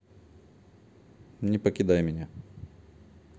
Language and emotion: Russian, neutral